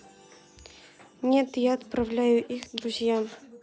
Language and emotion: Russian, neutral